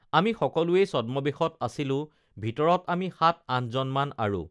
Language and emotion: Assamese, neutral